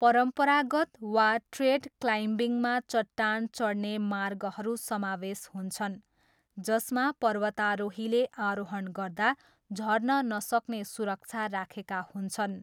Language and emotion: Nepali, neutral